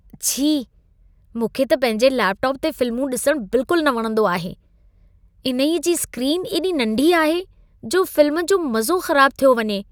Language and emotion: Sindhi, disgusted